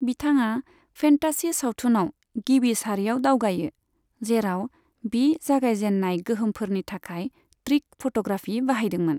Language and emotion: Bodo, neutral